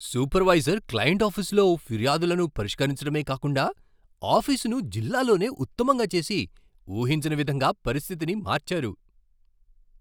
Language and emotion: Telugu, surprised